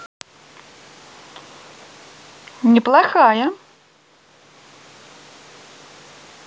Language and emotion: Russian, positive